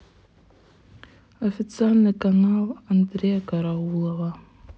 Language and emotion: Russian, sad